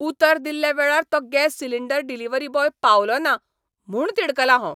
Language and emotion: Goan Konkani, angry